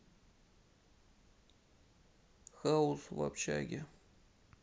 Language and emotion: Russian, sad